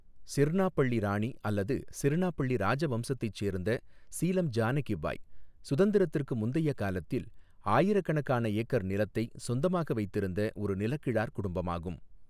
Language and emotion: Tamil, neutral